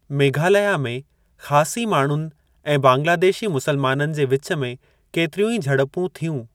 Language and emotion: Sindhi, neutral